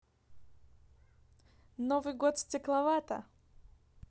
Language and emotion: Russian, neutral